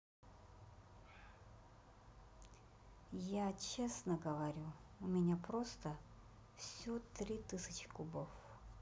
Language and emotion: Russian, neutral